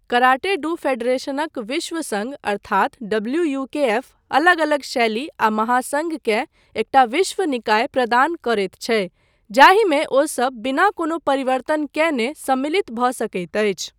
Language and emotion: Maithili, neutral